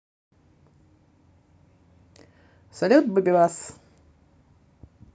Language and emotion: Russian, positive